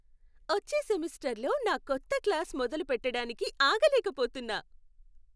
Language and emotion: Telugu, happy